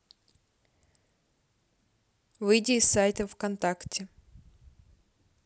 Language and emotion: Russian, neutral